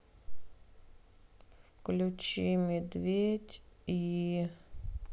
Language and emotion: Russian, sad